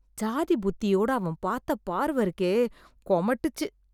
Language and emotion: Tamil, disgusted